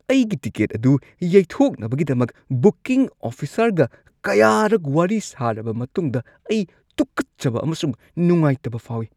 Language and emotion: Manipuri, disgusted